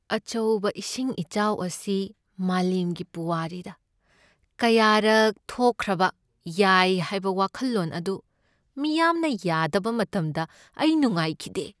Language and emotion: Manipuri, sad